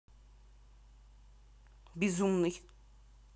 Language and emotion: Russian, neutral